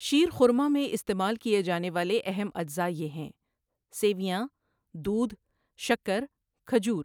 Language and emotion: Urdu, neutral